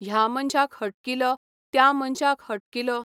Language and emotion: Goan Konkani, neutral